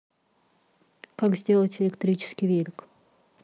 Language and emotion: Russian, neutral